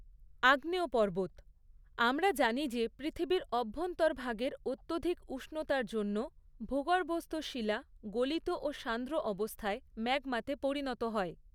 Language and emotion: Bengali, neutral